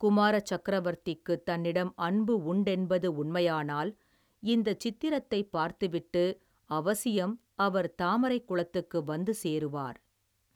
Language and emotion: Tamil, neutral